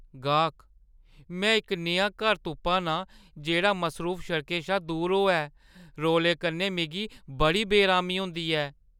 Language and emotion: Dogri, fearful